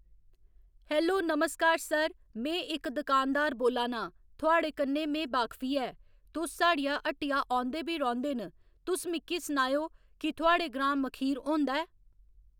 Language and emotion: Dogri, neutral